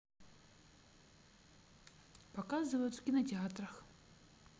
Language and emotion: Russian, neutral